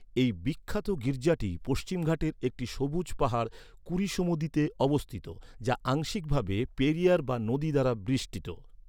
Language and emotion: Bengali, neutral